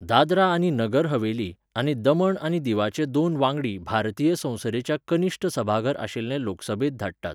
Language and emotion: Goan Konkani, neutral